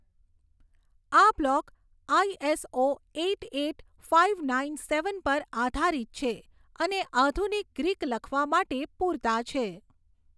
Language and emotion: Gujarati, neutral